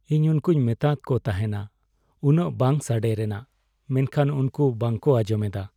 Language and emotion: Santali, sad